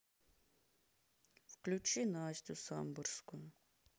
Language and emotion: Russian, sad